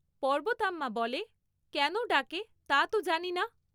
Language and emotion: Bengali, neutral